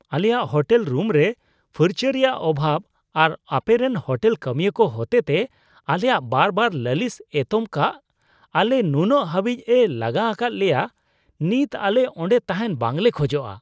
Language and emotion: Santali, disgusted